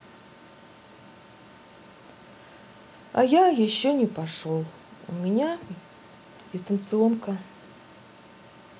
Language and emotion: Russian, sad